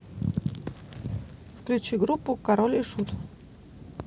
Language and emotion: Russian, neutral